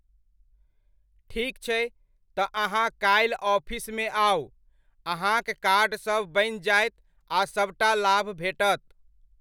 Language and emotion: Maithili, neutral